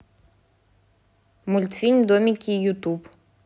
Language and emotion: Russian, neutral